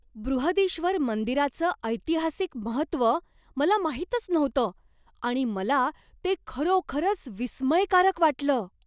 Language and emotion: Marathi, surprised